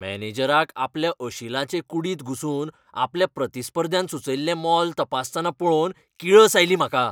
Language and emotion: Goan Konkani, angry